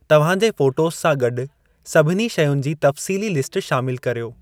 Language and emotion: Sindhi, neutral